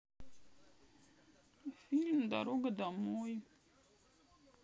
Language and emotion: Russian, sad